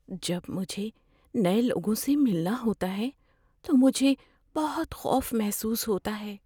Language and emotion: Urdu, fearful